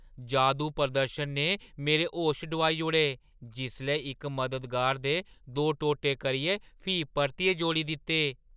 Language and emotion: Dogri, surprised